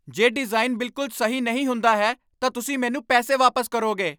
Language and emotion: Punjabi, angry